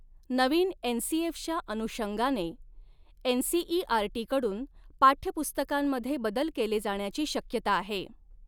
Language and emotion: Marathi, neutral